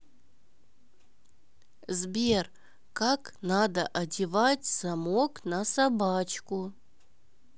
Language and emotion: Russian, neutral